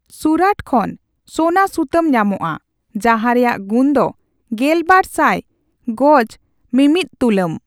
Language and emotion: Santali, neutral